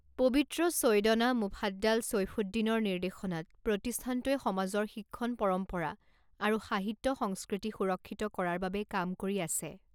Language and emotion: Assamese, neutral